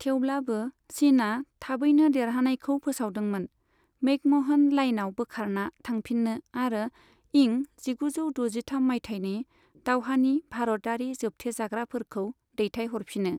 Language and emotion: Bodo, neutral